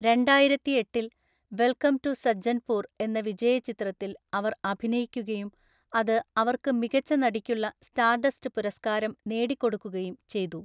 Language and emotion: Malayalam, neutral